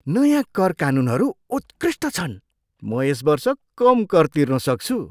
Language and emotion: Nepali, surprised